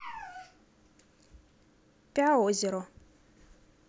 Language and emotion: Russian, neutral